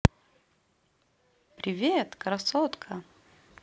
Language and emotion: Russian, positive